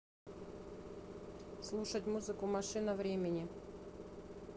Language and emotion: Russian, neutral